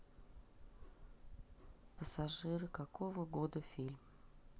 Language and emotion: Russian, neutral